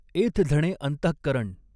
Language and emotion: Marathi, neutral